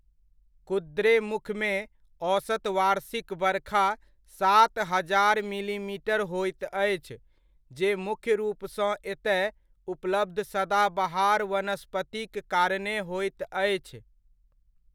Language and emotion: Maithili, neutral